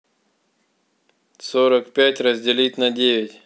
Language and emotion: Russian, neutral